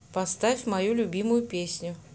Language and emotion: Russian, neutral